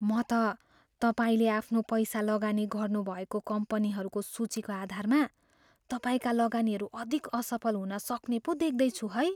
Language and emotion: Nepali, fearful